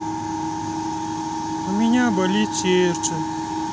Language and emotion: Russian, sad